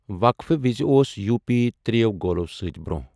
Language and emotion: Kashmiri, neutral